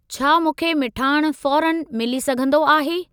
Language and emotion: Sindhi, neutral